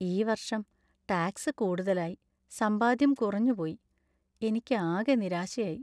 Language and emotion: Malayalam, sad